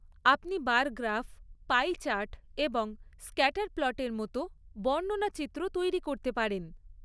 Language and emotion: Bengali, neutral